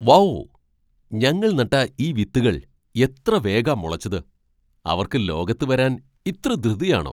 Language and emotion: Malayalam, surprised